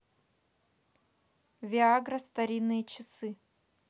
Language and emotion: Russian, neutral